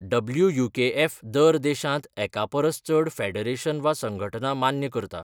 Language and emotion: Goan Konkani, neutral